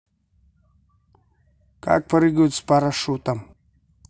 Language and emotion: Russian, neutral